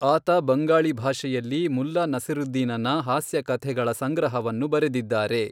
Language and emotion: Kannada, neutral